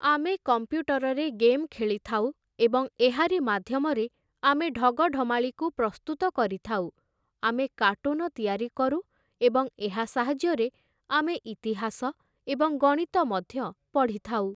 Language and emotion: Odia, neutral